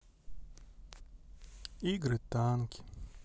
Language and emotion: Russian, sad